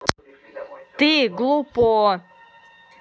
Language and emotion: Russian, angry